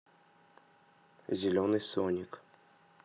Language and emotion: Russian, neutral